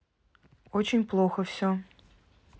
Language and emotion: Russian, neutral